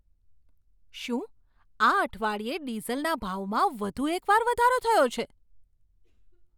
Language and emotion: Gujarati, surprised